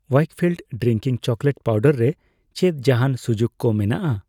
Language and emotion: Santali, neutral